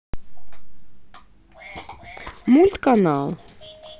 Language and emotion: Russian, neutral